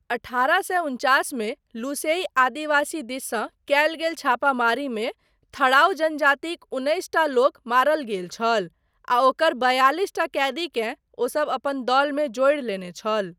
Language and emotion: Maithili, neutral